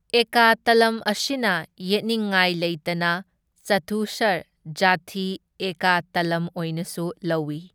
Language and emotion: Manipuri, neutral